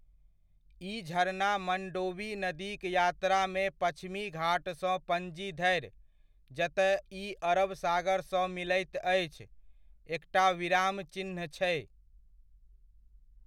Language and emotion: Maithili, neutral